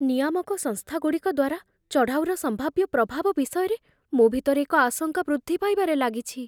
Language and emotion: Odia, fearful